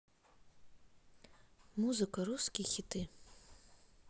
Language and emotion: Russian, neutral